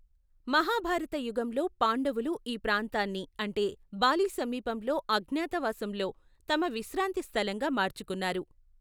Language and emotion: Telugu, neutral